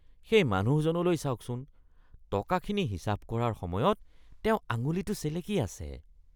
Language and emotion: Assamese, disgusted